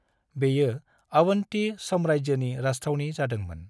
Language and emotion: Bodo, neutral